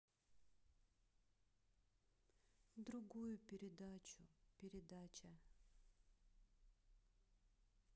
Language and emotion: Russian, neutral